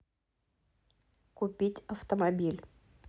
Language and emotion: Russian, neutral